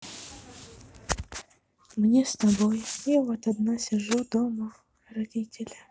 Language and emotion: Russian, sad